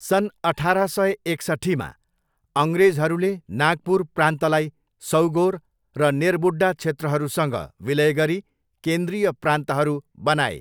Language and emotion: Nepali, neutral